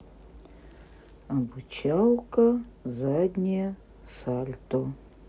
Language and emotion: Russian, neutral